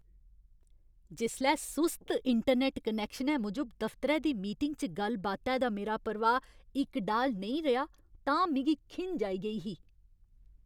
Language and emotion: Dogri, angry